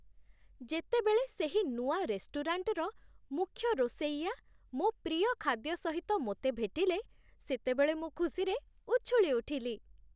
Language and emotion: Odia, happy